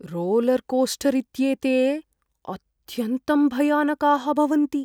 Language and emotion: Sanskrit, fearful